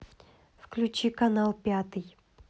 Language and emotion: Russian, neutral